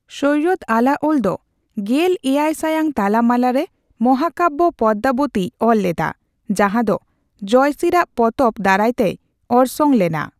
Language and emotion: Santali, neutral